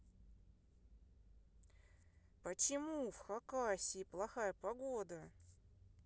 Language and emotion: Russian, angry